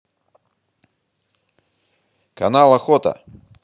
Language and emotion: Russian, positive